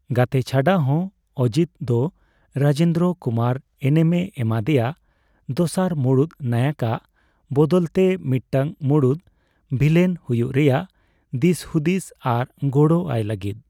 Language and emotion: Santali, neutral